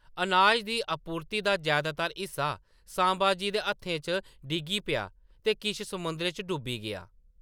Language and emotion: Dogri, neutral